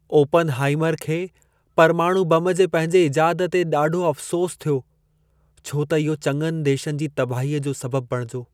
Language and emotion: Sindhi, sad